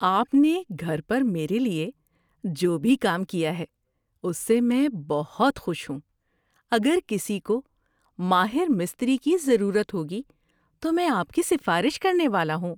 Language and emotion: Urdu, happy